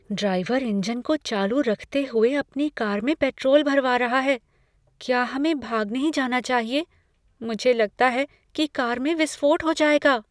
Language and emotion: Hindi, fearful